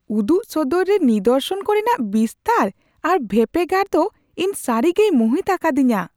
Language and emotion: Santali, surprised